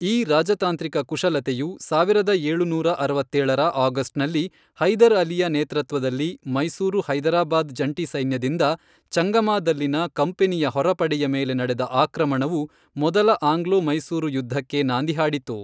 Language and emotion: Kannada, neutral